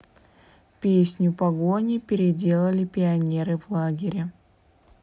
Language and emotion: Russian, neutral